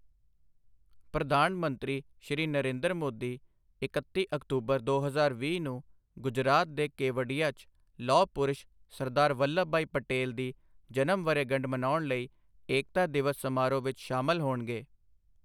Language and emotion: Punjabi, neutral